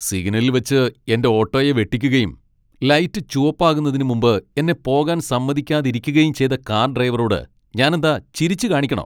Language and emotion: Malayalam, angry